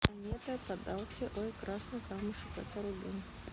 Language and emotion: Russian, neutral